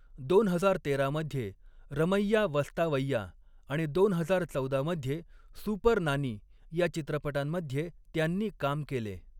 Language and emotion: Marathi, neutral